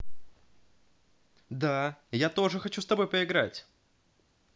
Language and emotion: Russian, positive